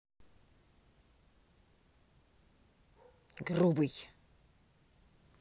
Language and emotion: Russian, angry